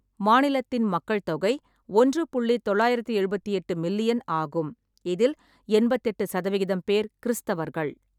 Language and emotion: Tamil, neutral